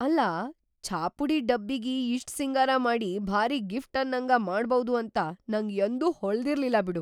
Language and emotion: Kannada, surprised